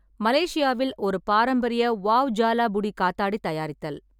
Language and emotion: Tamil, neutral